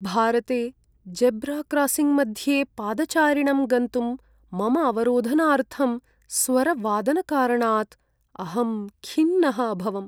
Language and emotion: Sanskrit, sad